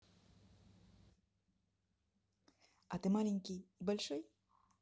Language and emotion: Russian, positive